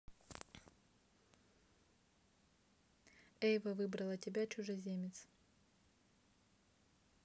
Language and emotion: Russian, neutral